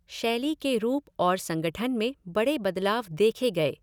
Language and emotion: Hindi, neutral